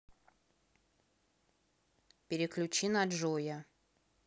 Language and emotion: Russian, neutral